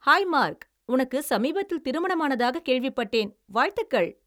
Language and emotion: Tamil, happy